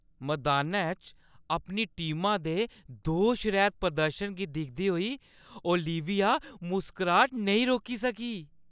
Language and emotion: Dogri, happy